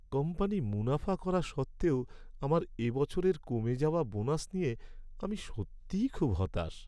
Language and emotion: Bengali, sad